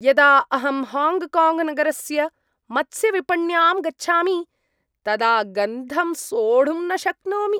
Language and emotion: Sanskrit, disgusted